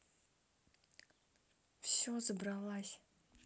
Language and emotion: Russian, neutral